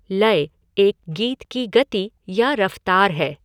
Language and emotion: Hindi, neutral